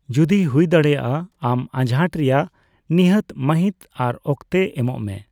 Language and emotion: Santali, neutral